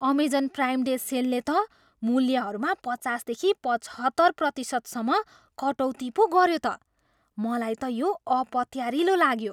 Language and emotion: Nepali, surprised